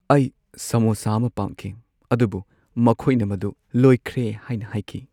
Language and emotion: Manipuri, sad